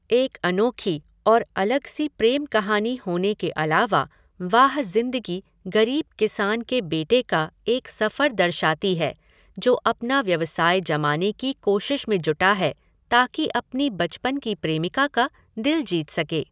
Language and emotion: Hindi, neutral